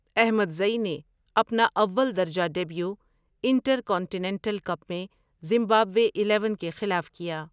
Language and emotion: Urdu, neutral